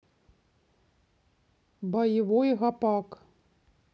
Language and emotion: Russian, neutral